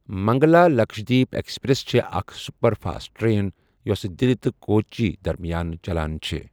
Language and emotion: Kashmiri, neutral